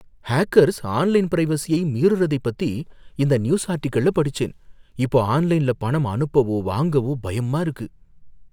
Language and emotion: Tamil, fearful